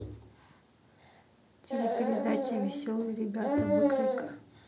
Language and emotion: Russian, neutral